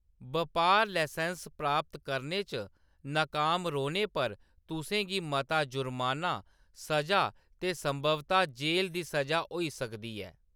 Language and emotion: Dogri, neutral